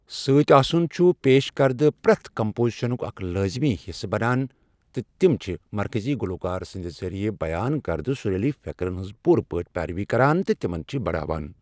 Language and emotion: Kashmiri, neutral